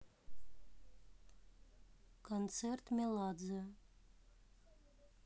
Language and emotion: Russian, neutral